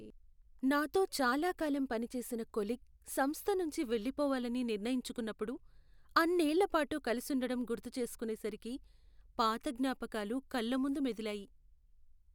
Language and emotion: Telugu, sad